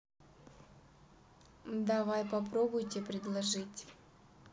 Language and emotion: Russian, neutral